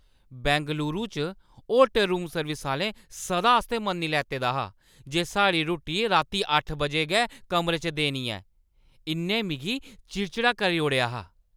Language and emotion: Dogri, angry